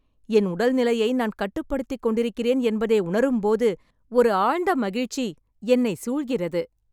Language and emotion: Tamil, happy